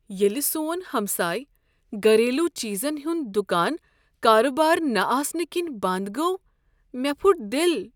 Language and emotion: Kashmiri, sad